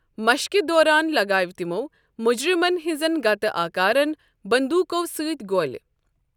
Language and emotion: Kashmiri, neutral